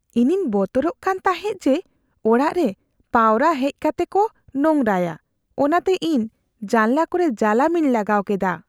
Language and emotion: Santali, fearful